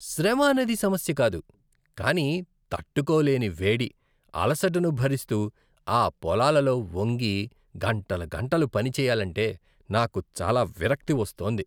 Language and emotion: Telugu, disgusted